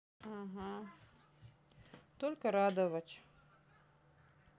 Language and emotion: Russian, sad